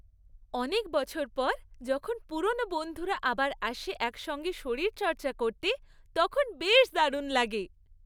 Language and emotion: Bengali, happy